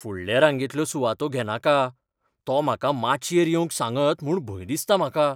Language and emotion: Goan Konkani, fearful